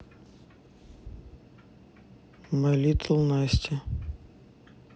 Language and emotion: Russian, neutral